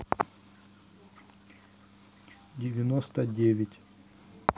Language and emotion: Russian, neutral